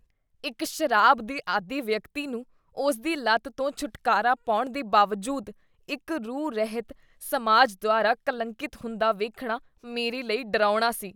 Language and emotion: Punjabi, disgusted